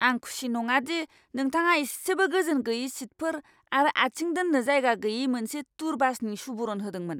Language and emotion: Bodo, angry